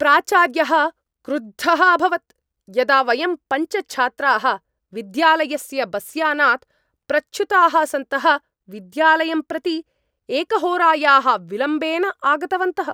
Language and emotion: Sanskrit, angry